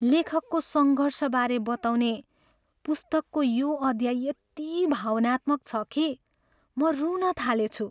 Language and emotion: Nepali, sad